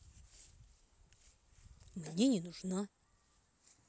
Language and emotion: Russian, neutral